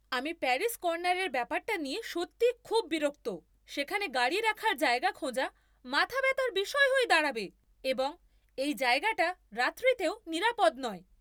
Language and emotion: Bengali, angry